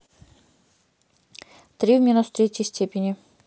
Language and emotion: Russian, neutral